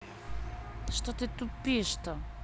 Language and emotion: Russian, angry